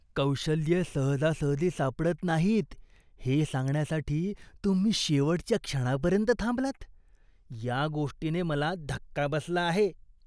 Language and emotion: Marathi, disgusted